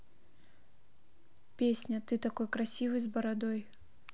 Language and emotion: Russian, neutral